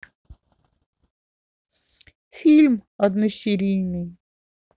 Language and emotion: Russian, neutral